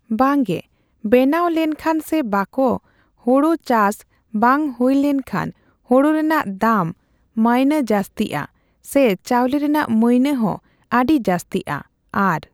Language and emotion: Santali, neutral